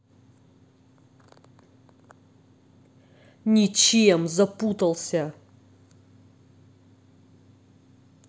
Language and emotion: Russian, angry